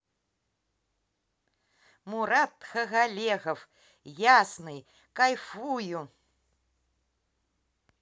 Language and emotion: Russian, positive